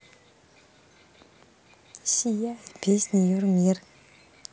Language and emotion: Russian, neutral